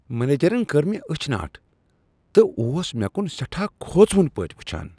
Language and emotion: Kashmiri, disgusted